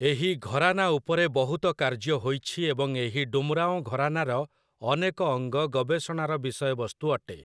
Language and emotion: Odia, neutral